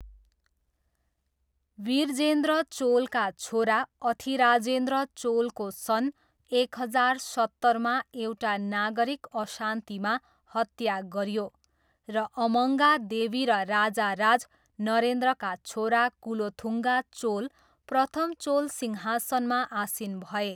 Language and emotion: Nepali, neutral